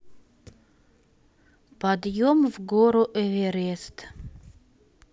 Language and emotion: Russian, neutral